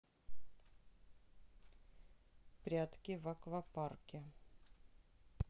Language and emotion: Russian, neutral